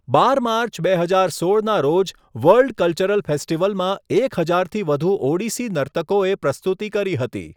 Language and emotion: Gujarati, neutral